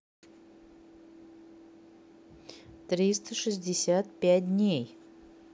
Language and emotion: Russian, neutral